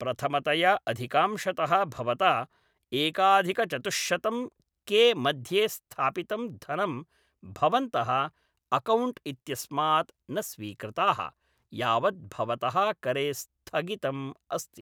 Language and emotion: Sanskrit, neutral